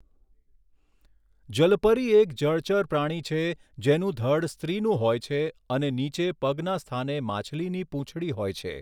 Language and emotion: Gujarati, neutral